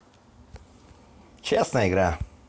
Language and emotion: Russian, positive